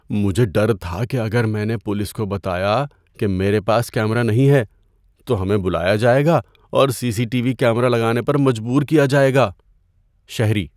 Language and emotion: Urdu, fearful